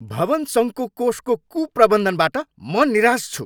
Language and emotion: Nepali, angry